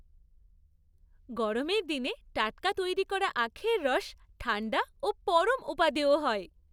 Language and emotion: Bengali, happy